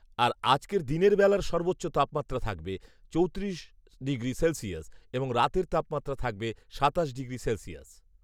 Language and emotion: Bengali, neutral